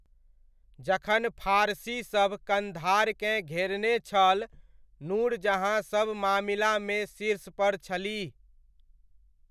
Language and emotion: Maithili, neutral